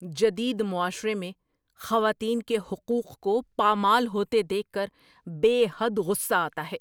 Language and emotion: Urdu, angry